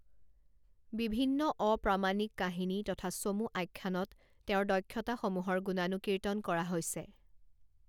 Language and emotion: Assamese, neutral